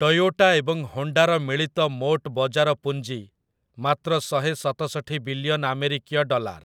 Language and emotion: Odia, neutral